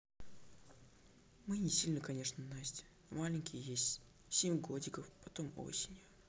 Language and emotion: Russian, neutral